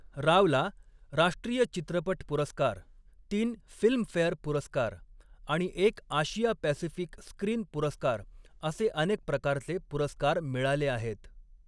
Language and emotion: Marathi, neutral